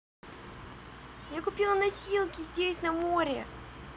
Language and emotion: Russian, positive